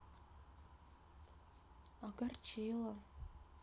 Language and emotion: Russian, sad